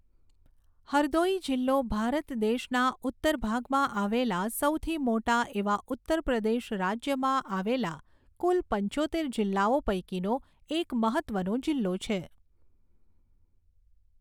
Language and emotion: Gujarati, neutral